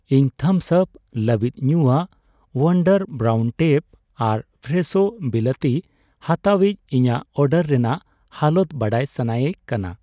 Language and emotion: Santali, neutral